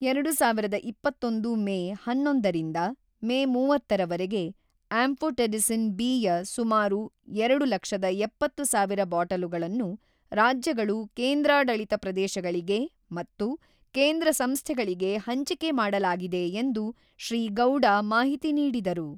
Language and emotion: Kannada, neutral